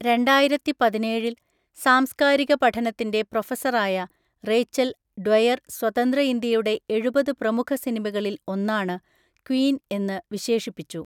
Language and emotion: Malayalam, neutral